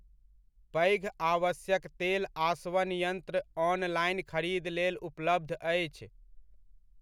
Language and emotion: Maithili, neutral